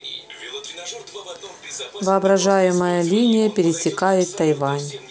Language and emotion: Russian, neutral